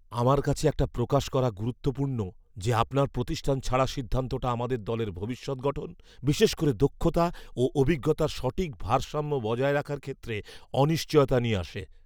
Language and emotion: Bengali, fearful